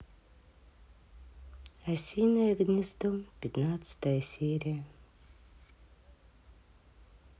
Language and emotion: Russian, sad